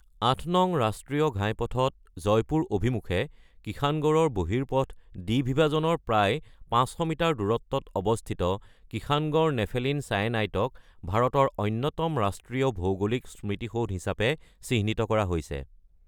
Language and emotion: Assamese, neutral